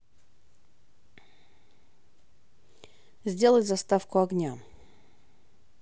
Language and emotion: Russian, neutral